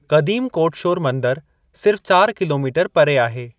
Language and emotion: Sindhi, neutral